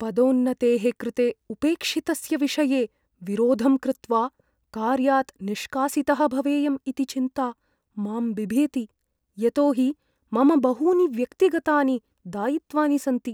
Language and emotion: Sanskrit, fearful